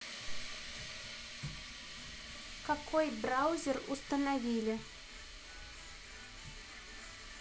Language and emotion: Russian, neutral